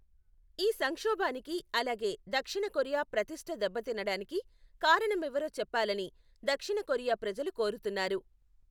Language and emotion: Telugu, neutral